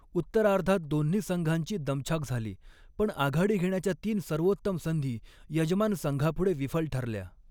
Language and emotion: Marathi, neutral